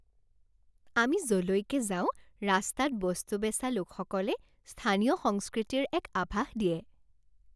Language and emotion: Assamese, happy